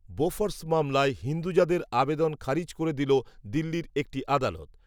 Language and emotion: Bengali, neutral